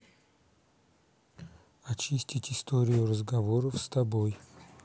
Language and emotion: Russian, neutral